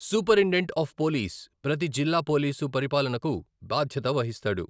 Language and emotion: Telugu, neutral